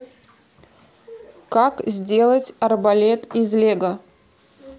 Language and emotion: Russian, neutral